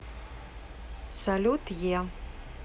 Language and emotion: Russian, neutral